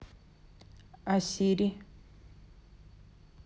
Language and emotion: Russian, neutral